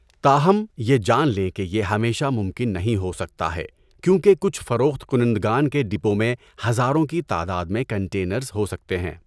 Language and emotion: Urdu, neutral